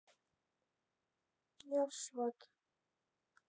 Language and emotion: Russian, sad